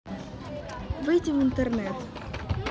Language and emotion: Russian, neutral